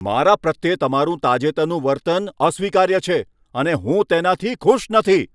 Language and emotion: Gujarati, angry